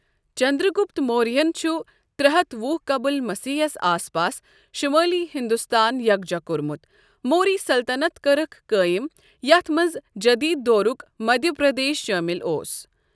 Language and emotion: Kashmiri, neutral